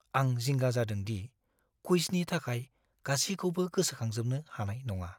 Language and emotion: Bodo, fearful